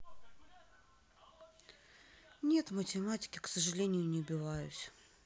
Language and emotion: Russian, sad